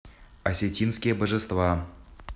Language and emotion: Russian, neutral